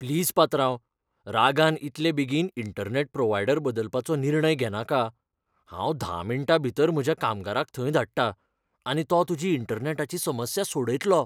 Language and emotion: Goan Konkani, fearful